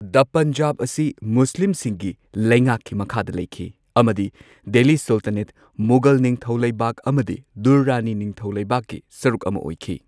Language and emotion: Manipuri, neutral